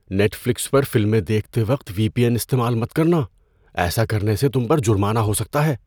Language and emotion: Urdu, fearful